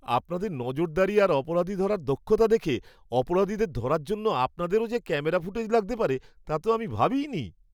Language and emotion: Bengali, surprised